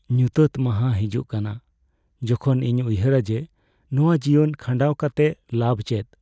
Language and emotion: Santali, sad